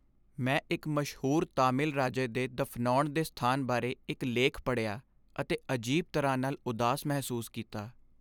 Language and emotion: Punjabi, sad